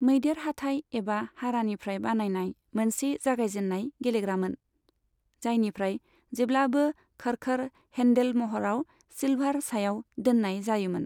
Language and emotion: Bodo, neutral